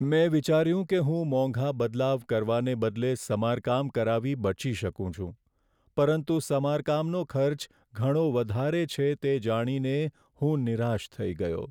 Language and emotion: Gujarati, sad